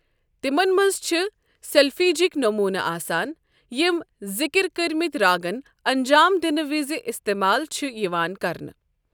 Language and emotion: Kashmiri, neutral